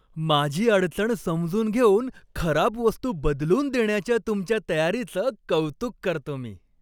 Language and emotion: Marathi, happy